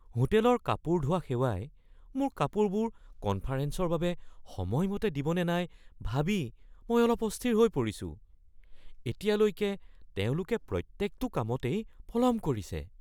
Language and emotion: Assamese, fearful